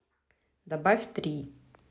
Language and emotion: Russian, neutral